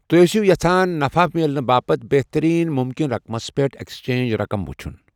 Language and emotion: Kashmiri, neutral